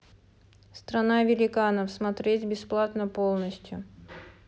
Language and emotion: Russian, neutral